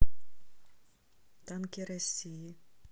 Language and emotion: Russian, neutral